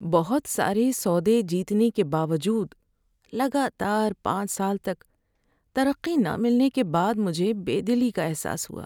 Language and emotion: Urdu, sad